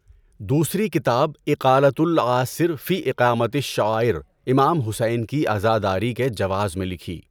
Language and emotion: Urdu, neutral